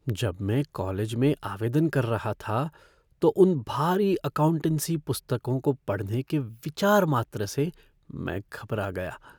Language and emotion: Hindi, fearful